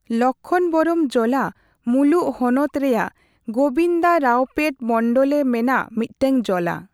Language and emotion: Santali, neutral